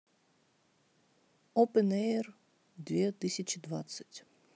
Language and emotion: Russian, neutral